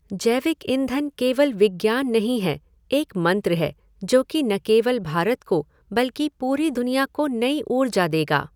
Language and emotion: Hindi, neutral